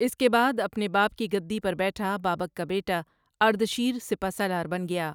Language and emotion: Urdu, neutral